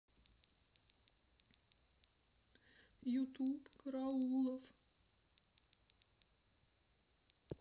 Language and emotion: Russian, sad